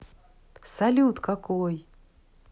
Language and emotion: Russian, positive